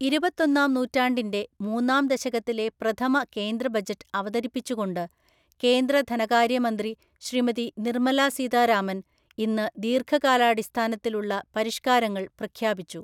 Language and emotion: Malayalam, neutral